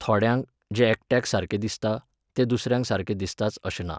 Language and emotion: Goan Konkani, neutral